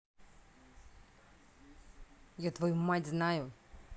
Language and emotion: Russian, angry